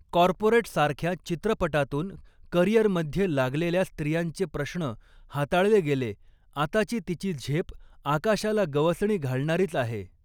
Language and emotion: Marathi, neutral